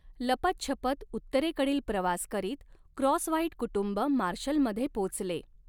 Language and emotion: Marathi, neutral